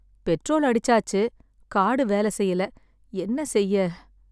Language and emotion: Tamil, sad